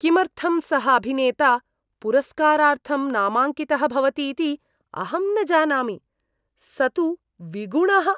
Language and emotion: Sanskrit, disgusted